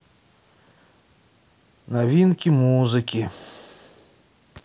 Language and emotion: Russian, sad